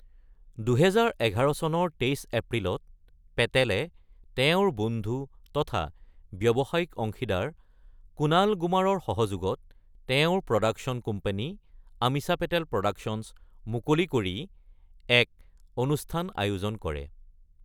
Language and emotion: Assamese, neutral